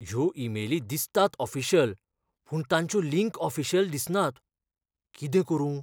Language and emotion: Goan Konkani, fearful